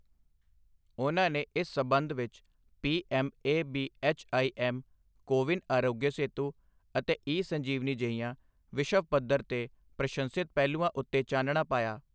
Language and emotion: Punjabi, neutral